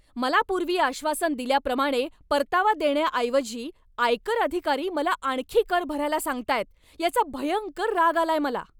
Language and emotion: Marathi, angry